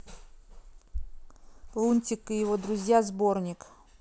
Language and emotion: Russian, neutral